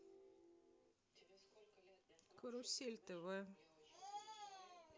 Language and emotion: Russian, neutral